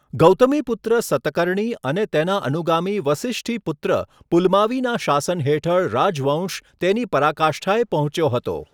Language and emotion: Gujarati, neutral